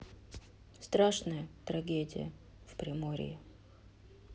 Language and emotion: Russian, sad